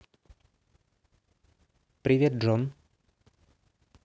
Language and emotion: Russian, neutral